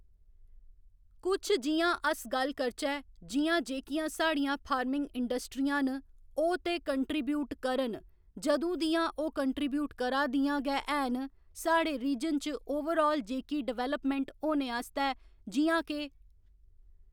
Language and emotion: Dogri, neutral